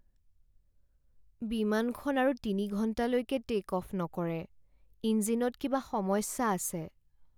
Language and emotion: Assamese, sad